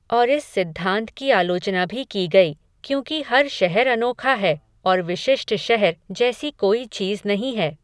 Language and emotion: Hindi, neutral